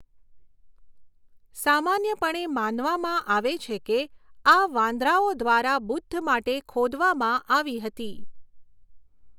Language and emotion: Gujarati, neutral